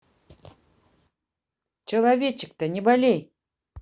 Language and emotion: Russian, positive